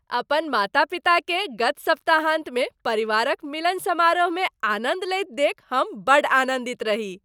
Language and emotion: Maithili, happy